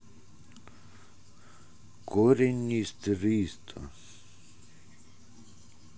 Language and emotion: Russian, neutral